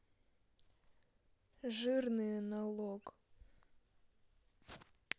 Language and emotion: Russian, neutral